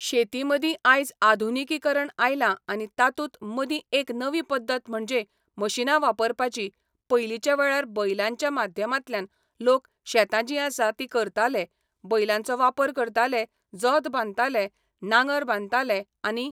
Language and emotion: Goan Konkani, neutral